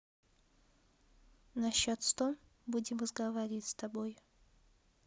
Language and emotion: Russian, neutral